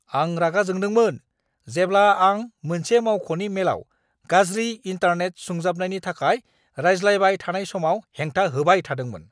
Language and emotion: Bodo, angry